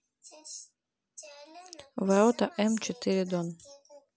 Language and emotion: Russian, neutral